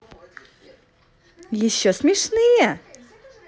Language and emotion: Russian, positive